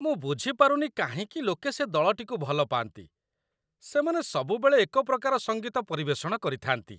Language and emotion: Odia, disgusted